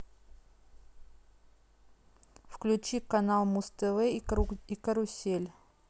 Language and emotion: Russian, neutral